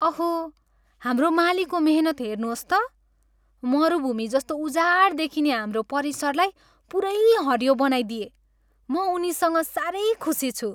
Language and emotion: Nepali, happy